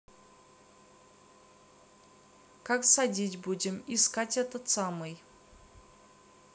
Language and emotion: Russian, neutral